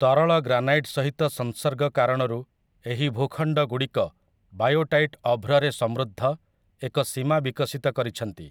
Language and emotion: Odia, neutral